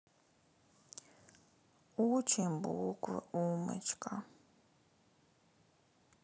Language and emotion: Russian, sad